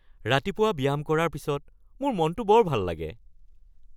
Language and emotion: Assamese, happy